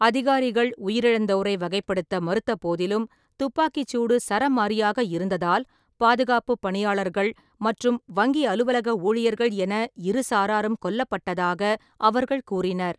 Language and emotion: Tamil, neutral